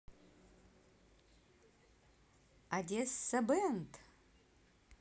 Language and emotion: Russian, positive